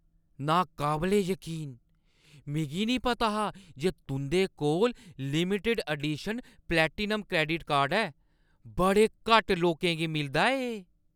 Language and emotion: Dogri, surprised